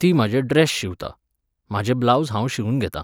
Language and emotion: Goan Konkani, neutral